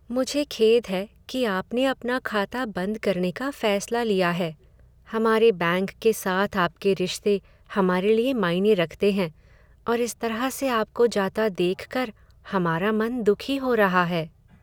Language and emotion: Hindi, sad